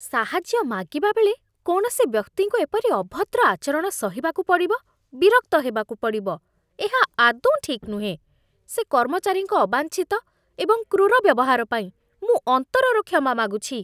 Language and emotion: Odia, disgusted